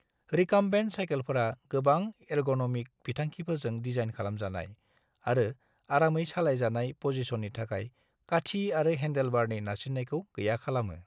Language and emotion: Bodo, neutral